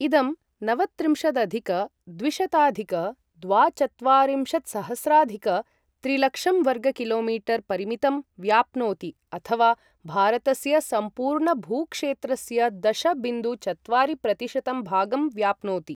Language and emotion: Sanskrit, neutral